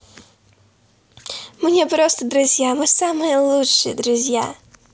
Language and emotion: Russian, positive